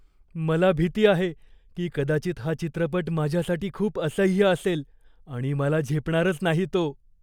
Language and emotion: Marathi, fearful